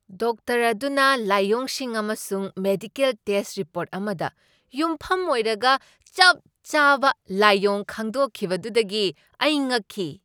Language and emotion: Manipuri, surprised